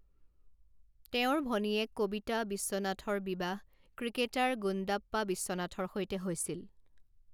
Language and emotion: Assamese, neutral